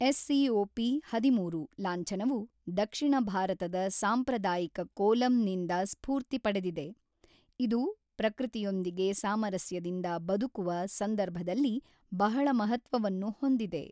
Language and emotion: Kannada, neutral